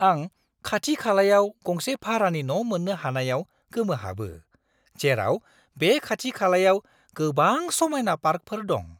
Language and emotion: Bodo, surprised